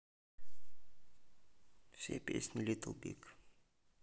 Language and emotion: Russian, neutral